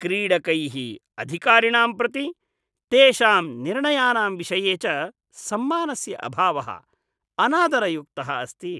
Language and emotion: Sanskrit, disgusted